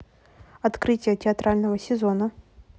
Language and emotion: Russian, neutral